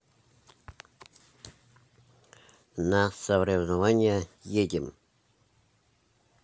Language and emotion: Russian, neutral